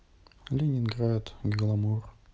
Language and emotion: Russian, sad